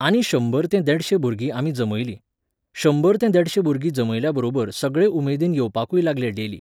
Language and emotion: Goan Konkani, neutral